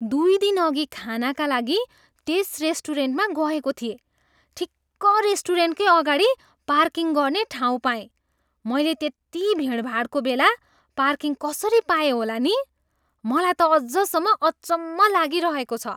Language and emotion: Nepali, surprised